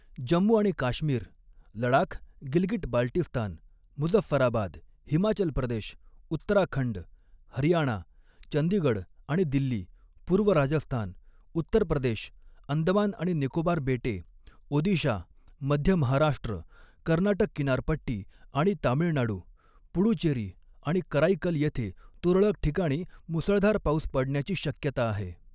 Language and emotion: Marathi, neutral